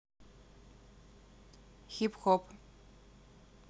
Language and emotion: Russian, neutral